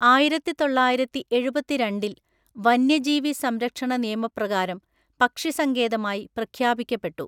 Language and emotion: Malayalam, neutral